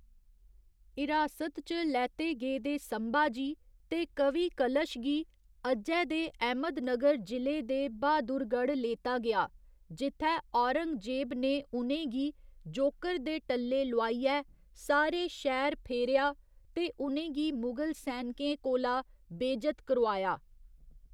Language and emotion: Dogri, neutral